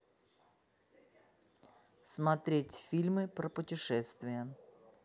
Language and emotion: Russian, neutral